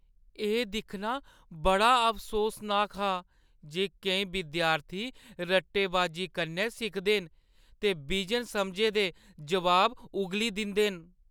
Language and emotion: Dogri, sad